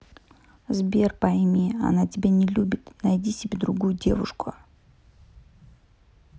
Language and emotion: Russian, neutral